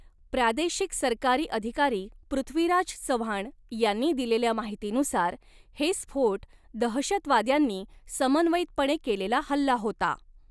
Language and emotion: Marathi, neutral